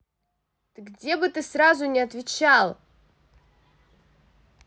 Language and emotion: Russian, angry